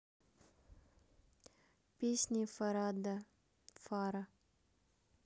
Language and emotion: Russian, neutral